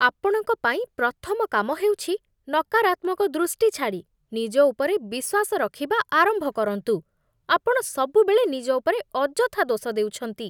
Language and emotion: Odia, disgusted